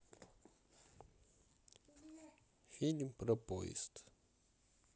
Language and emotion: Russian, sad